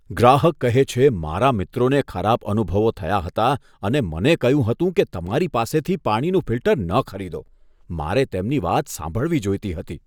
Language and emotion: Gujarati, disgusted